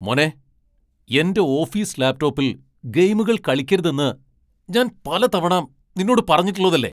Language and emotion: Malayalam, angry